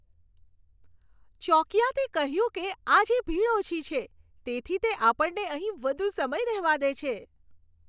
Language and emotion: Gujarati, happy